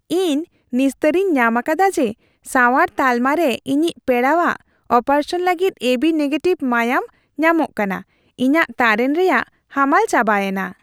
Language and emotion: Santali, happy